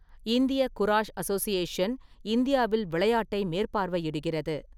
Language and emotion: Tamil, neutral